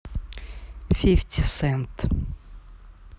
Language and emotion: Russian, neutral